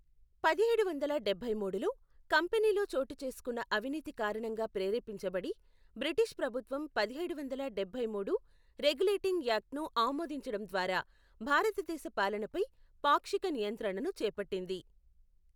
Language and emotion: Telugu, neutral